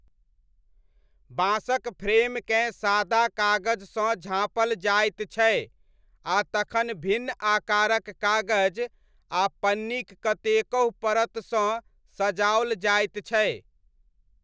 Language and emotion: Maithili, neutral